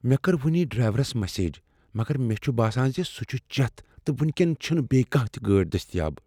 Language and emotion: Kashmiri, fearful